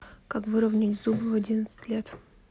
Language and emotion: Russian, neutral